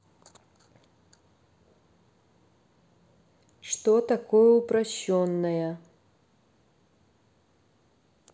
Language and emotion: Russian, neutral